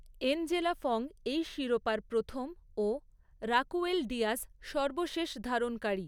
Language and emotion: Bengali, neutral